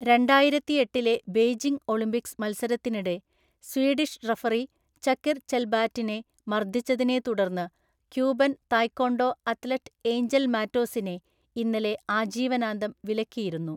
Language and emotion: Malayalam, neutral